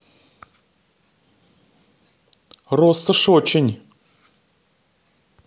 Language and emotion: Russian, neutral